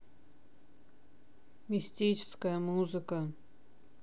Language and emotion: Russian, neutral